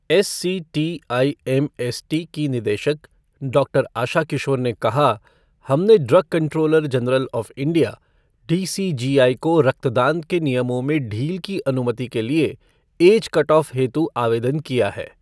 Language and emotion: Hindi, neutral